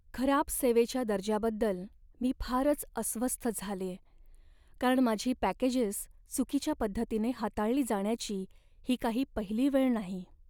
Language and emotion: Marathi, sad